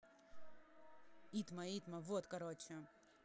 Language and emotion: Russian, neutral